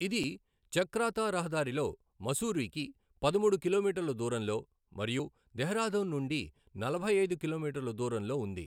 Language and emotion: Telugu, neutral